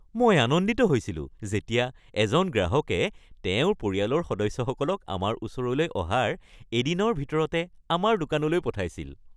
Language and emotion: Assamese, happy